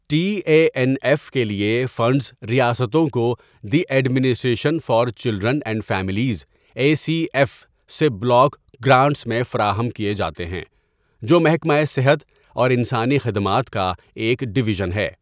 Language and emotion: Urdu, neutral